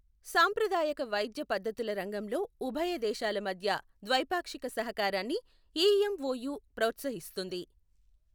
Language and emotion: Telugu, neutral